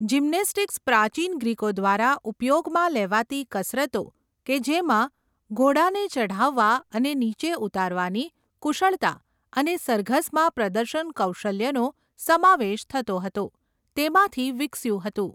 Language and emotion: Gujarati, neutral